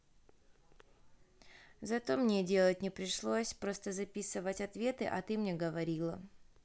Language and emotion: Russian, neutral